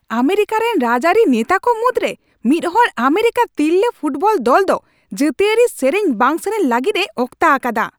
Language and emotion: Santali, angry